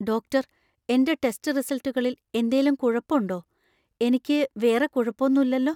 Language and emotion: Malayalam, fearful